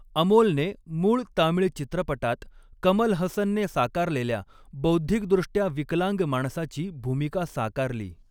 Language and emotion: Marathi, neutral